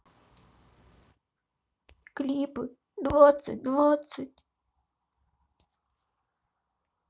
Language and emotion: Russian, sad